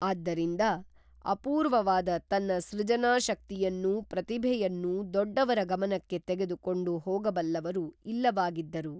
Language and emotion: Kannada, neutral